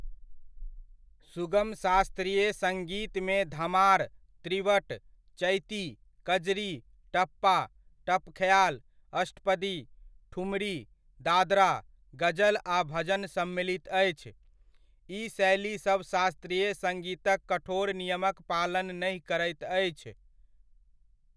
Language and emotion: Maithili, neutral